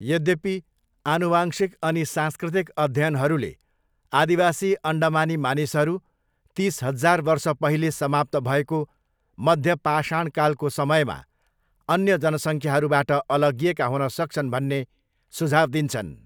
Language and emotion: Nepali, neutral